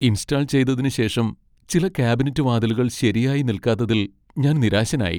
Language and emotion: Malayalam, sad